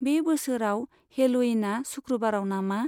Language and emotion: Bodo, neutral